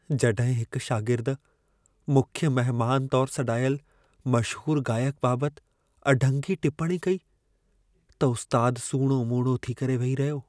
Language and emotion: Sindhi, sad